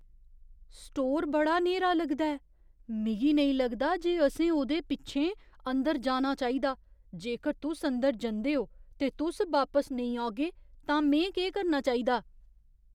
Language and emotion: Dogri, fearful